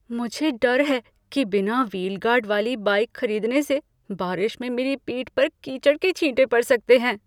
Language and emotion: Hindi, fearful